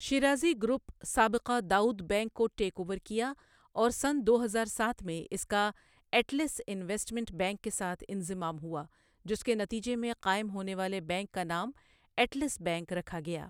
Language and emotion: Urdu, neutral